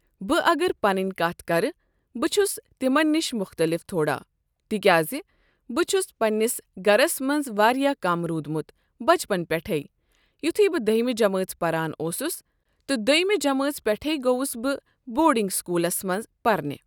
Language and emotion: Kashmiri, neutral